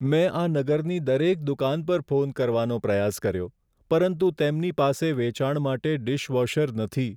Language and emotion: Gujarati, sad